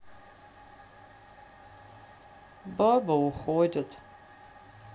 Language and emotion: Russian, sad